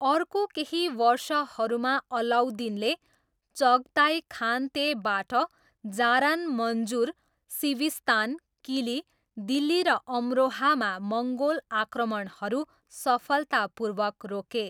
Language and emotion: Nepali, neutral